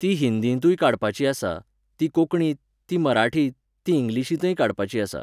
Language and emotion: Goan Konkani, neutral